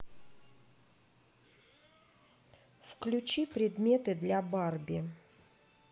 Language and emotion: Russian, neutral